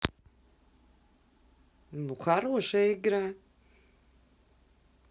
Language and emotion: Russian, positive